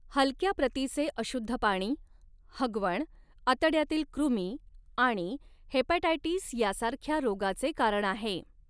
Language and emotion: Marathi, neutral